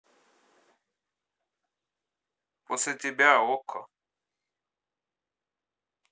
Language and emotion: Russian, neutral